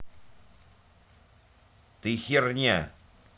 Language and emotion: Russian, angry